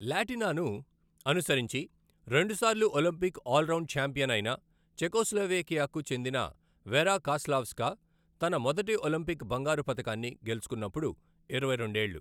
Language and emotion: Telugu, neutral